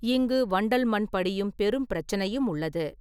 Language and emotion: Tamil, neutral